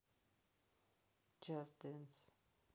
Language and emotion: Russian, neutral